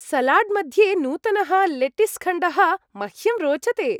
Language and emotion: Sanskrit, happy